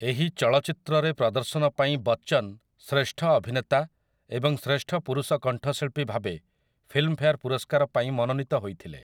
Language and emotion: Odia, neutral